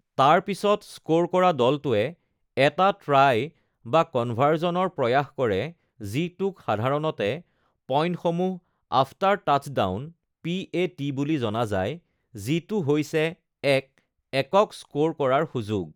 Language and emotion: Assamese, neutral